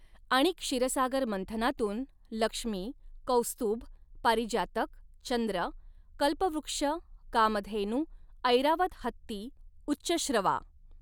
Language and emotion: Marathi, neutral